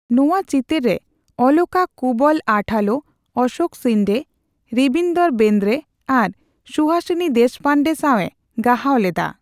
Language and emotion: Santali, neutral